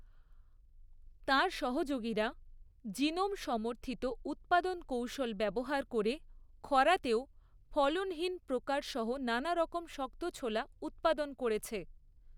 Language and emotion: Bengali, neutral